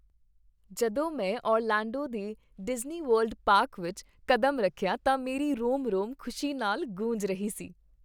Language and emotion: Punjabi, happy